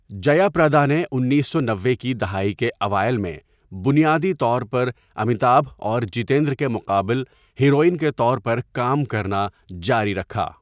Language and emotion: Urdu, neutral